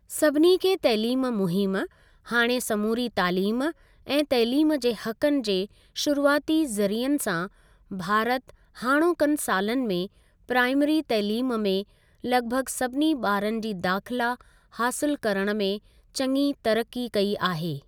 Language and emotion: Sindhi, neutral